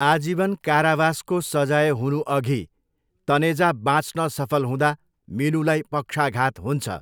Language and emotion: Nepali, neutral